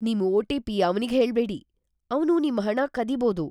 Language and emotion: Kannada, fearful